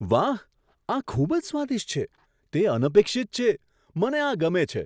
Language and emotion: Gujarati, surprised